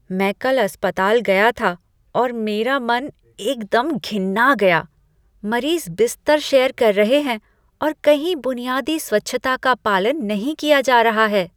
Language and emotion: Hindi, disgusted